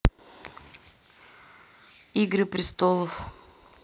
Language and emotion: Russian, neutral